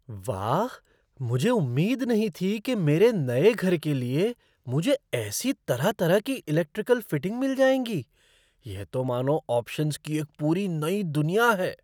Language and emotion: Hindi, surprised